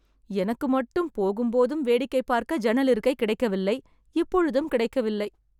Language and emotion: Tamil, sad